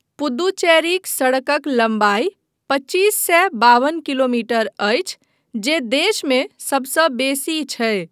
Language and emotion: Maithili, neutral